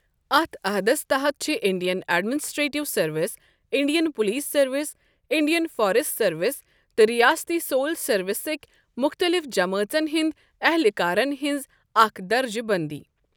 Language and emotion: Kashmiri, neutral